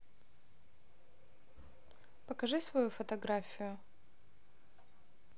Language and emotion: Russian, neutral